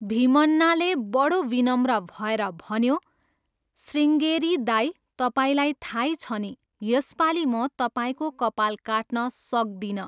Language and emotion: Nepali, neutral